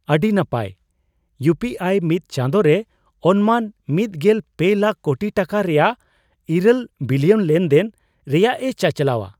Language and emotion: Santali, surprised